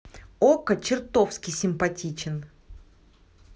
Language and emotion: Russian, neutral